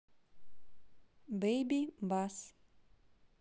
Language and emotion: Russian, neutral